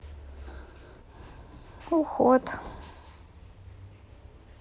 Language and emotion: Russian, sad